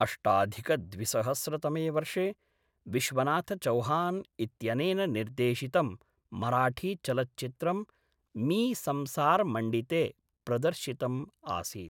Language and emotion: Sanskrit, neutral